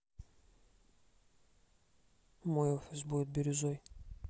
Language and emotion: Russian, neutral